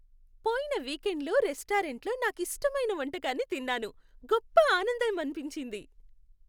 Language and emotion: Telugu, happy